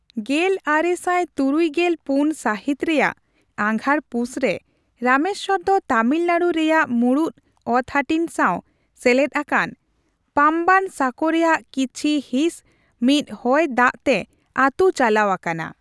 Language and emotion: Santali, neutral